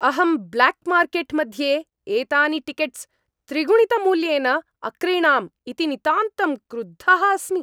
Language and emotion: Sanskrit, angry